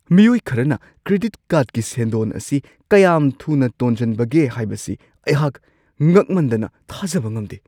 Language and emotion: Manipuri, surprised